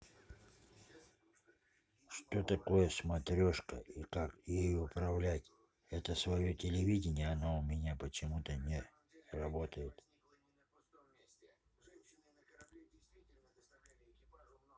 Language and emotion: Russian, neutral